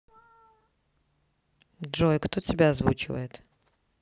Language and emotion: Russian, neutral